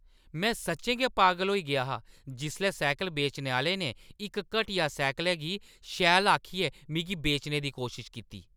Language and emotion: Dogri, angry